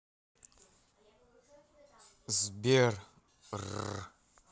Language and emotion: Russian, neutral